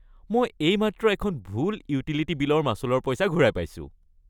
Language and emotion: Assamese, happy